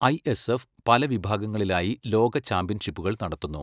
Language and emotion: Malayalam, neutral